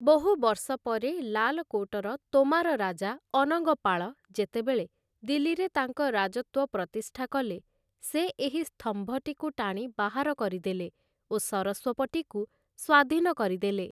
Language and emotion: Odia, neutral